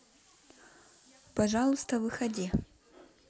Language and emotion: Russian, neutral